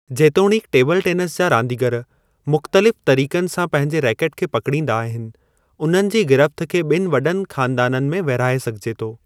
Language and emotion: Sindhi, neutral